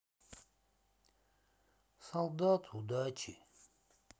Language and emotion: Russian, sad